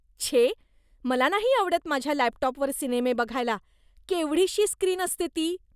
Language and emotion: Marathi, disgusted